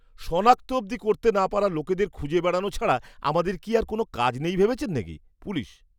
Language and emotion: Bengali, disgusted